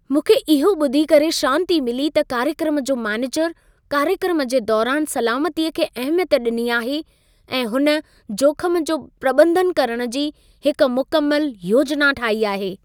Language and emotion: Sindhi, happy